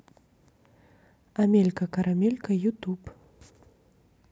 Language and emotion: Russian, neutral